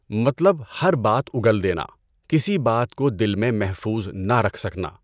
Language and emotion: Urdu, neutral